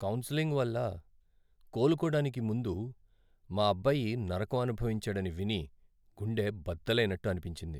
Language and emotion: Telugu, sad